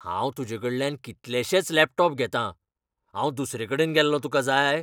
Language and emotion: Goan Konkani, angry